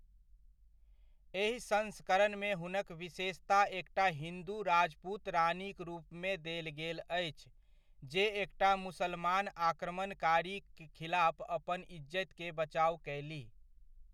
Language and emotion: Maithili, neutral